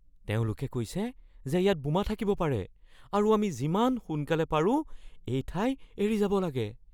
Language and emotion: Assamese, fearful